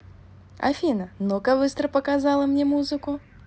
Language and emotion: Russian, positive